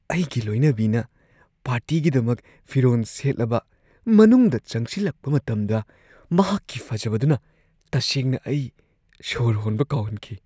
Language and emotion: Manipuri, surprised